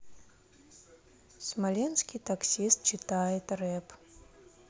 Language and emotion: Russian, neutral